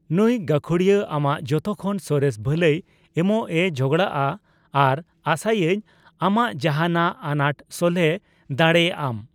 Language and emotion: Santali, neutral